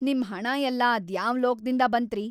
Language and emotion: Kannada, angry